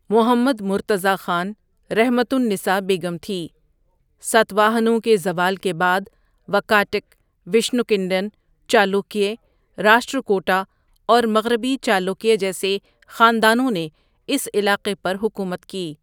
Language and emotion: Urdu, neutral